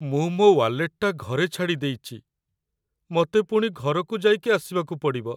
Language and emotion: Odia, sad